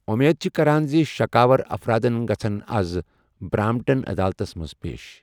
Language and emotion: Kashmiri, neutral